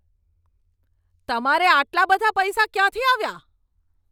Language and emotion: Gujarati, angry